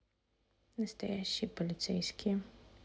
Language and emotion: Russian, neutral